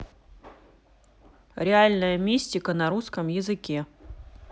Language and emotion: Russian, neutral